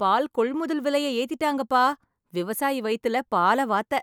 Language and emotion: Tamil, happy